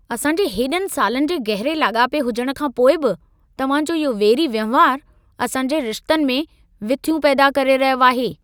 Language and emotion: Sindhi, angry